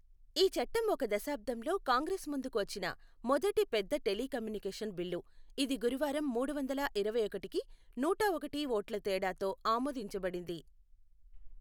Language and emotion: Telugu, neutral